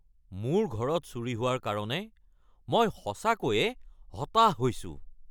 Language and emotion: Assamese, angry